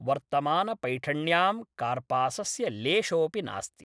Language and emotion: Sanskrit, neutral